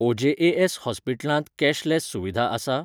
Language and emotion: Goan Konkani, neutral